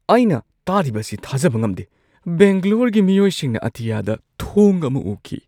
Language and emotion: Manipuri, surprised